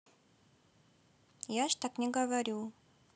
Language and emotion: Russian, neutral